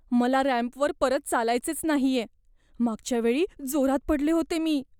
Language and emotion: Marathi, fearful